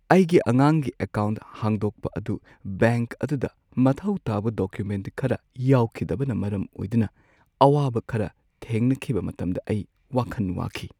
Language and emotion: Manipuri, sad